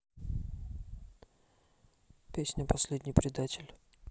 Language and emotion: Russian, neutral